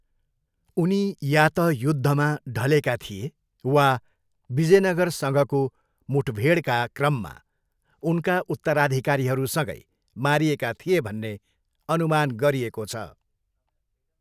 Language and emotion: Nepali, neutral